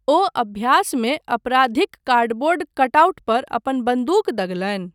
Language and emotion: Maithili, neutral